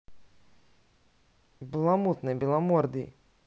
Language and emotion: Russian, neutral